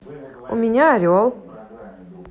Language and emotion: Russian, positive